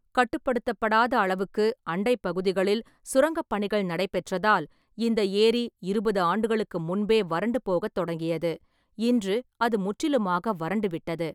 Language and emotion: Tamil, neutral